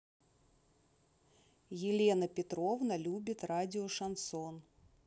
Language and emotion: Russian, neutral